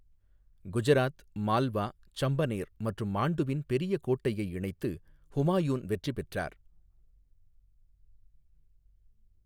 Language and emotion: Tamil, neutral